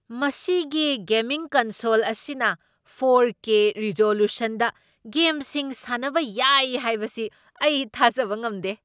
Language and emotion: Manipuri, surprised